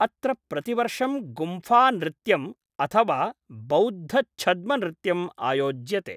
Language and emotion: Sanskrit, neutral